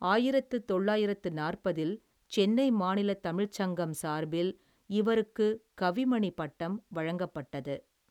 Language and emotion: Tamil, neutral